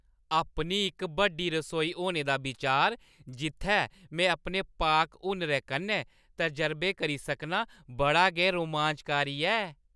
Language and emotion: Dogri, happy